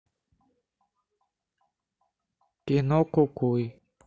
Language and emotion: Russian, neutral